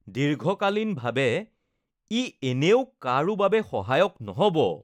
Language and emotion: Assamese, disgusted